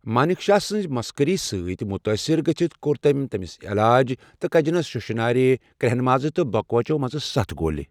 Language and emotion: Kashmiri, neutral